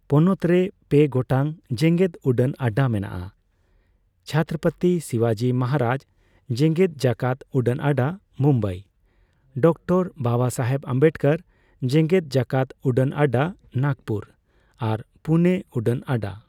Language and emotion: Santali, neutral